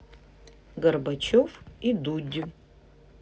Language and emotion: Russian, neutral